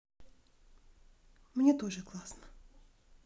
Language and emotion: Russian, sad